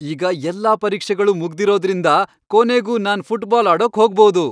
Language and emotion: Kannada, happy